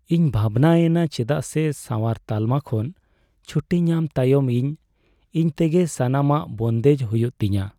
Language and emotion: Santali, sad